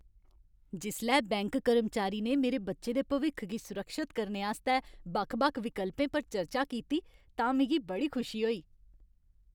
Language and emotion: Dogri, happy